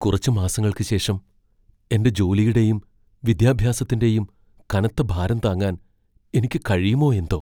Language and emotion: Malayalam, fearful